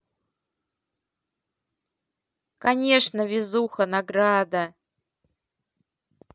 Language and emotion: Russian, positive